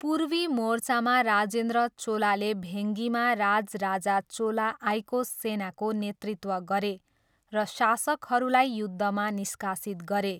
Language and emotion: Nepali, neutral